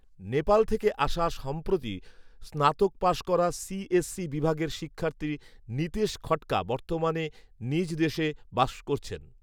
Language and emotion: Bengali, neutral